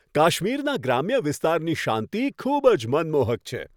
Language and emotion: Gujarati, happy